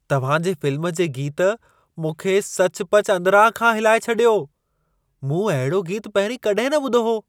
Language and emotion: Sindhi, surprised